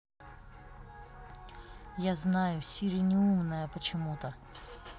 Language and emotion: Russian, neutral